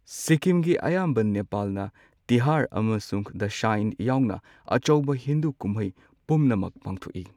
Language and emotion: Manipuri, neutral